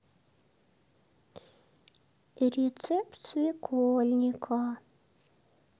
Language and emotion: Russian, neutral